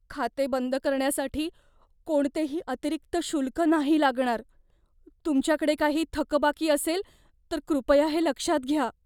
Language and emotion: Marathi, fearful